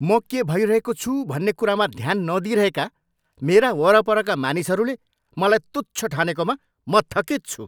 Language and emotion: Nepali, angry